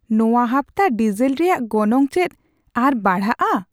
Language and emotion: Santali, surprised